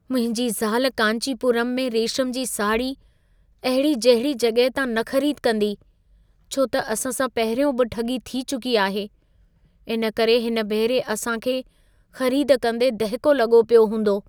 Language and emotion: Sindhi, fearful